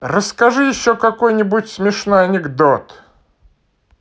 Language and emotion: Russian, positive